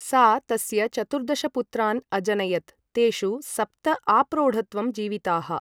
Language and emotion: Sanskrit, neutral